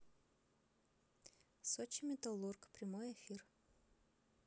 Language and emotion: Russian, neutral